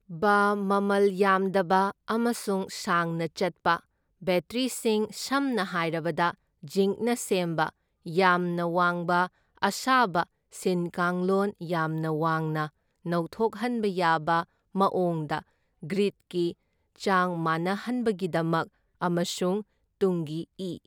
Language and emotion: Manipuri, neutral